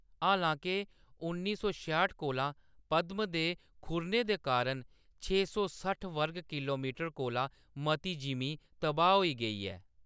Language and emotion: Dogri, neutral